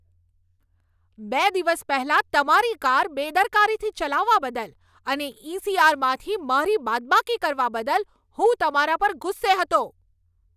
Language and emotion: Gujarati, angry